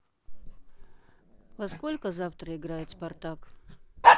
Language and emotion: Russian, neutral